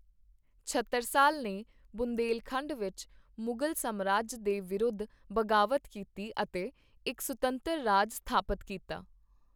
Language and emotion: Punjabi, neutral